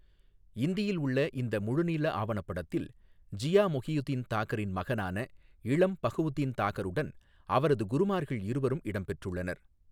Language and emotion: Tamil, neutral